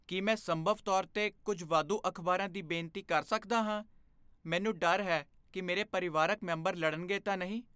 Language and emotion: Punjabi, fearful